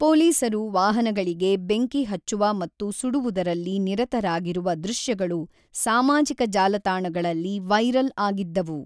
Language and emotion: Kannada, neutral